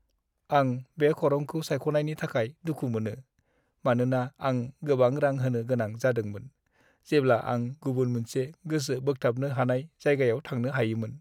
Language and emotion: Bodo, sad